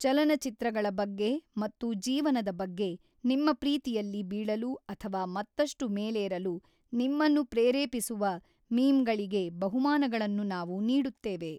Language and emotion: Kannada, neutral